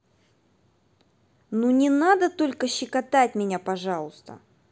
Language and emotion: Russian, angry